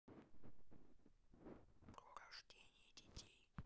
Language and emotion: Russian, neutral